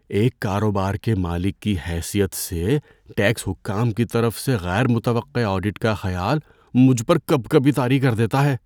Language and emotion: Urdu, fearful